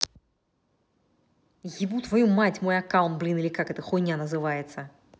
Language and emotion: Russian, angry